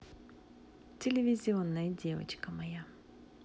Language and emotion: Russian, positive